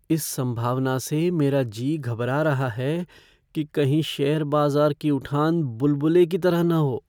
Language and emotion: Hindi, fearful